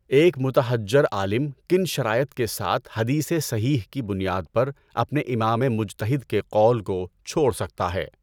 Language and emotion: Urdu, neutral